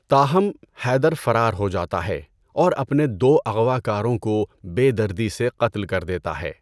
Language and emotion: Urdu, neutral